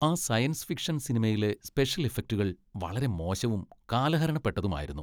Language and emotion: Malayalam, disgusted